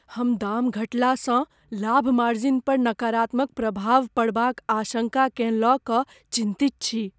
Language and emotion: Maithili, fearful